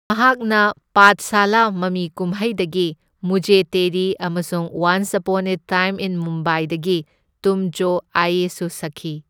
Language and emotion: Manipuri, neutral